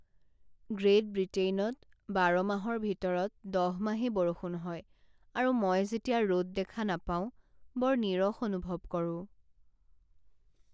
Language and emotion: Assamese, sad